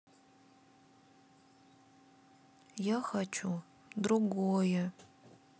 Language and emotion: Russian, sad